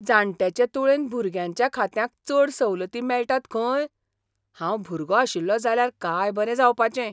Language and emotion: Goan Konkani, surprised